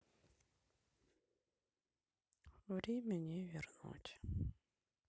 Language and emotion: Russian, sad